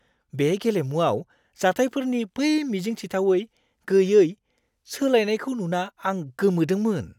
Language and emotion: Bodo, surprised